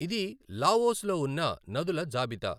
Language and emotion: Telugu, neutral